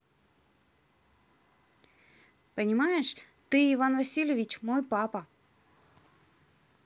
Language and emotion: Russian, neutral